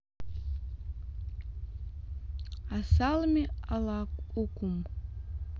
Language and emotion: Russian, neutral